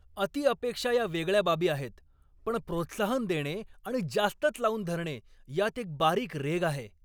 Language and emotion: Marathi, angry